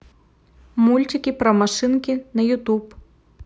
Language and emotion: Russian, neutral